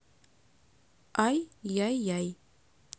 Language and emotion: Russian, neutral